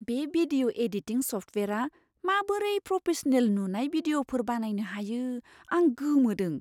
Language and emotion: Bodo, surprised